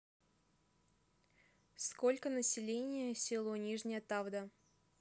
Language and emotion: Russian, neutral